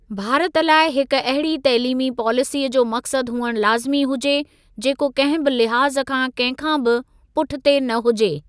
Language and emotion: Sindhi, neutral